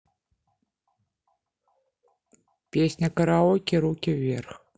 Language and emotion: Russian, neutral